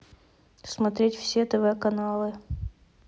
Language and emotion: Russian, neutral